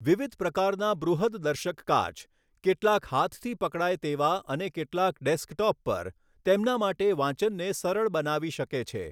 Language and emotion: Gujarati, neutral